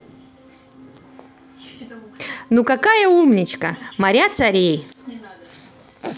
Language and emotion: Russian, positive